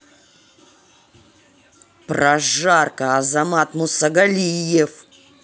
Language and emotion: Russian, angry